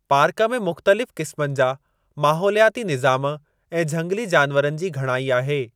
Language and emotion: Sindhi, neutral